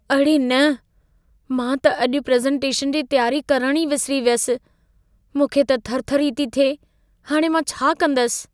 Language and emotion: Sindhi, fearful